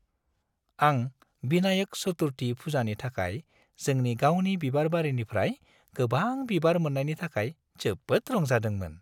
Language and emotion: Bodo, happy